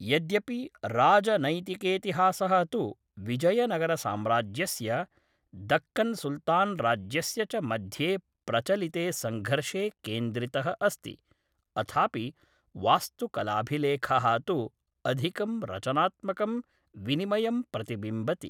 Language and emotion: Sanskrit, neutral